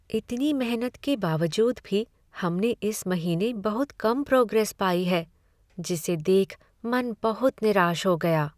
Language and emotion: Hindi, sad